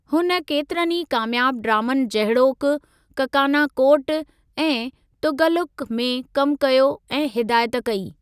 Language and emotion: Sindhi, neutral